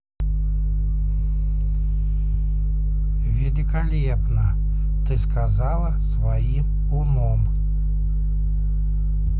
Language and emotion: Russian, neutral